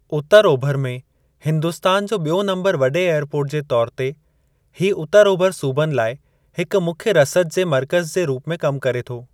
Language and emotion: Sindhi, neutral